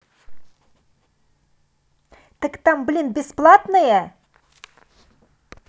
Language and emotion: Russian, angry